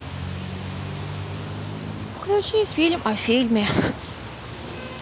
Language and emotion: Russian, sad